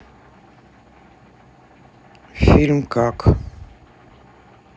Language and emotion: Russian, neutral